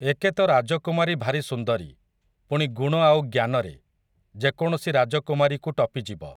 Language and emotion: Odia, neutral